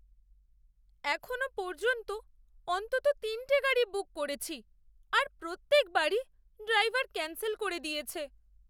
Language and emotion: Bengali, sad